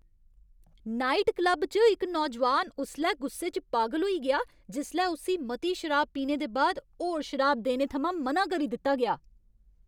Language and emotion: Dogri, angry